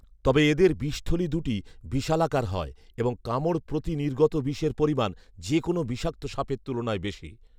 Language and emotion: Bengali, neutral